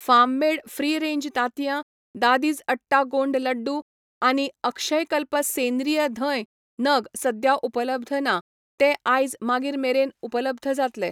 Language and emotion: Goan Konkani, neutral